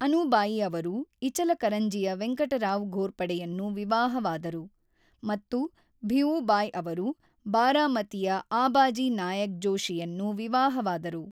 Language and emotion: Kannada, neutral